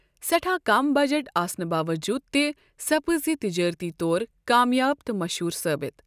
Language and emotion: Kashmiri, neutral